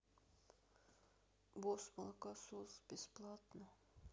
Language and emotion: Russian, sad